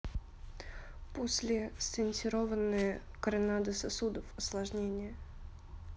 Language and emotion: Russian, neutral